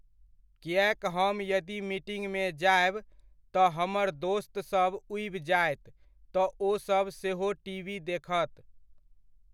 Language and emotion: Maithili, neutral